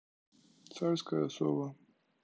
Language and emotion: Russian, neutral